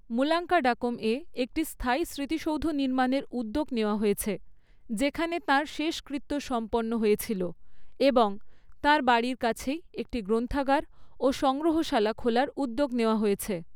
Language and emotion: Bengali, neutral